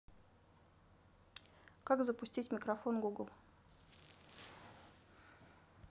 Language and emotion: Russian, neutral